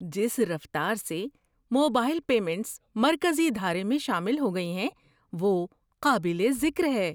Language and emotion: Urdu, surprised